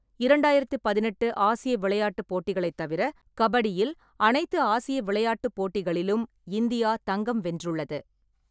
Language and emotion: Tamil, neutral